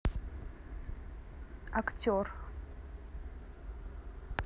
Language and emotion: Russian, neutral